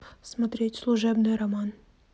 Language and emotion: Russian, neutral